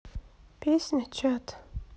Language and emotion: Russian, sad